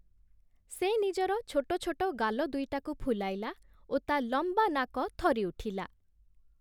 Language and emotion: Odia, neutral